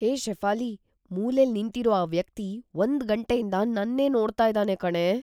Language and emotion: Kannada, fearful